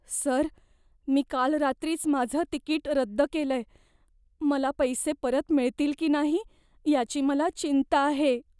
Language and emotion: Marathi, fearful